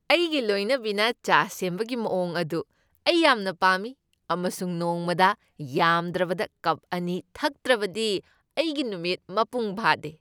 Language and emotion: Manipuri, happy